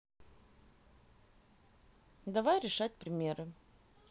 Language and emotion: Russian, neutral